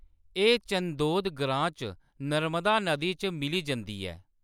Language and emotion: Dogri, neutral